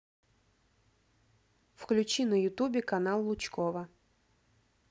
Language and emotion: Russian, neutral